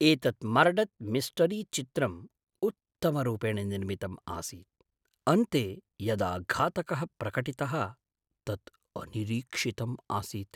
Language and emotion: Sanskrit, surprised